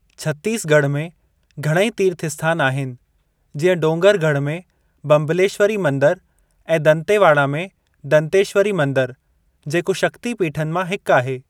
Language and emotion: Sindhi, neutral